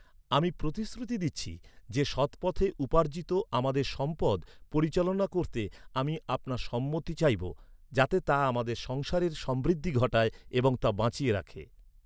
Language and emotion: Bengali, neutral